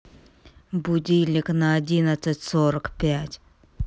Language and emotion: Russian, angry